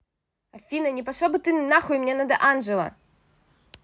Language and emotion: Russian, angry